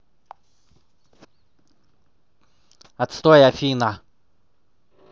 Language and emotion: Russian, angry